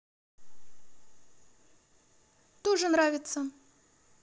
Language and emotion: Russian, neutral